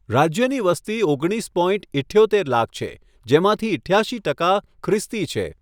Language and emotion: Gujarati, neutral